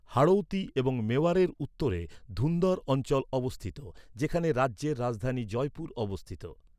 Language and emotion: Bengali, neutral